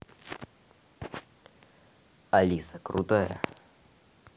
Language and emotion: Russian, neutral